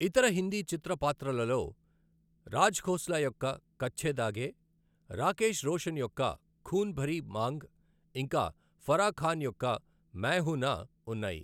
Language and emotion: Telugu, neutral